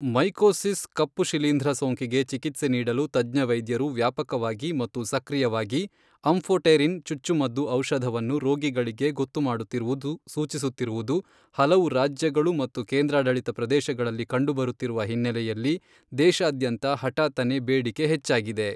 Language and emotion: Kannada, neutral